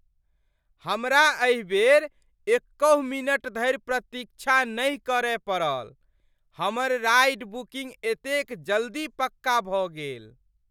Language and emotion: Maithili, surprised